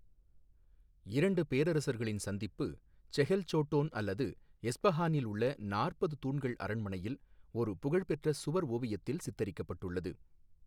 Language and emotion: Tamil, neutral